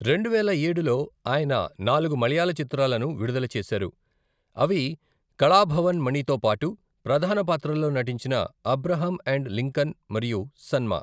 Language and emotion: Telugu, neutral